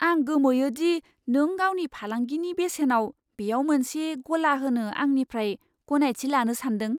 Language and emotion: Bodo, surprised